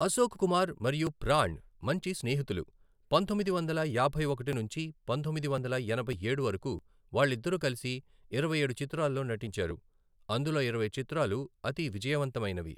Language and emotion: Telugu, neutral